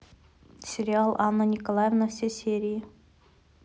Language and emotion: Russian, neutral